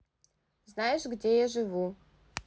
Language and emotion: Russian, neutral